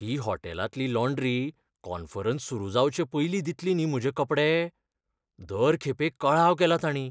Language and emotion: Goan Konkani, fearful